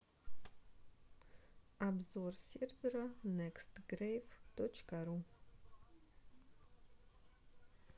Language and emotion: Russian, neutral